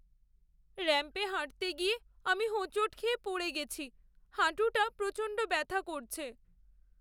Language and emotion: Bengali, sad